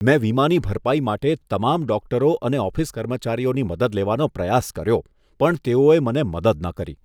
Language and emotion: Gujarati, disgusted